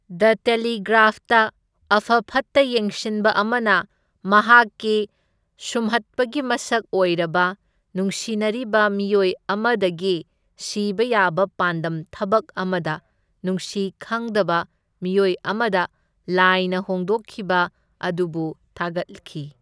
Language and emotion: Manipuri, neutral